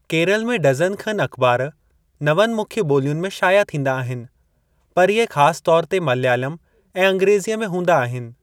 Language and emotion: Sindhi, neutral